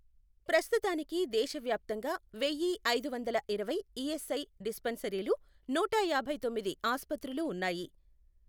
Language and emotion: Telugu, neutral